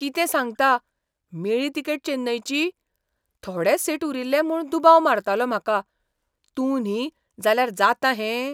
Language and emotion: Goan Konkani, surprised